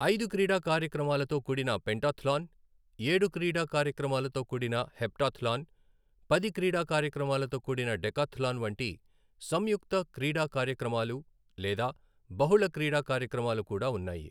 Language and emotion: Telugu, neutral